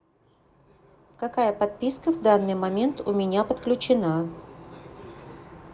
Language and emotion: Russian, neutral